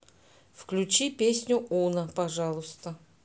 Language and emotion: Russian, neutral